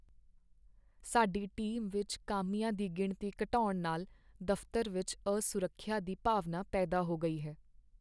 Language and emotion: Punjabi, sad